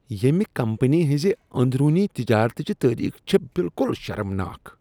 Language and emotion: Kashmiri, disgusted